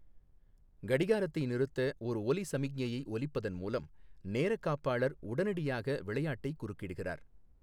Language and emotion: Tamil, neutral